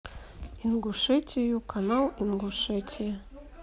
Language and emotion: Russian, neutral